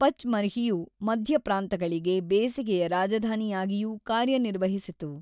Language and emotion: Kannada, neutral